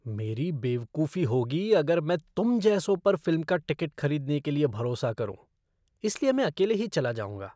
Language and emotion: Hindi, disgusted